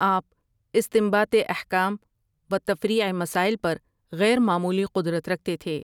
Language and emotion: Urdu, neutral